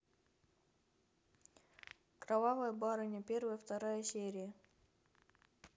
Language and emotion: Russian, neutral